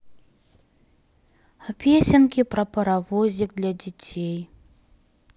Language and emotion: Russian, sad